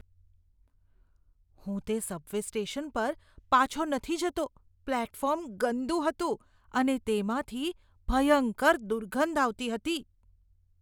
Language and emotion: Gujarati, disgusted